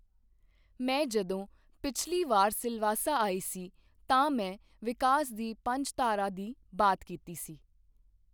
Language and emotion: Punjabi, neutral